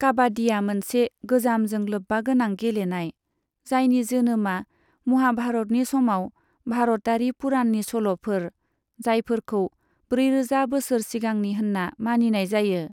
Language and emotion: Bodo, neutral